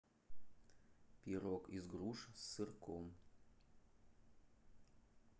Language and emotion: Russian, neutral